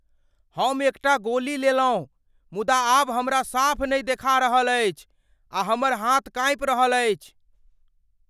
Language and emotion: Maithili, fearful